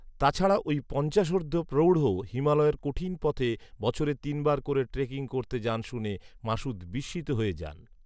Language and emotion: Bengali, neutral